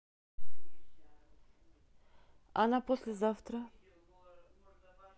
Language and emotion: Russian, neutral